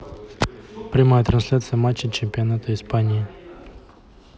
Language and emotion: Russian, neutral